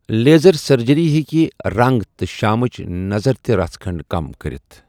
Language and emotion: Kashmiri, neutral